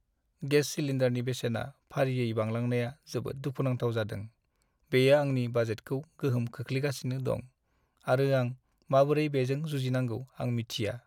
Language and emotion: Bodo, sad